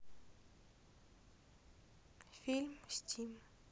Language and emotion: Russian, sad